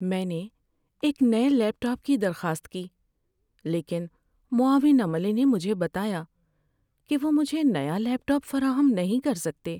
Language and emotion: Urdu, sad